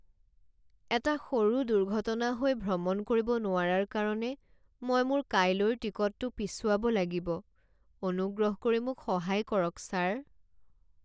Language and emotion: Assamese, sad